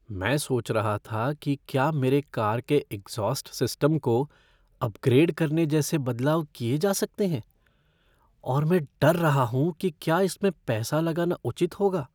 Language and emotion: Hindi, fearful